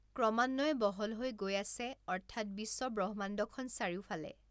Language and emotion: Assamese, neutral